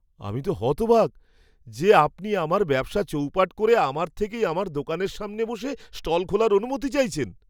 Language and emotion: Bengali, surprised